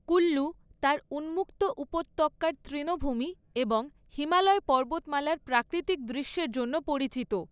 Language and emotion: Bengali, neutral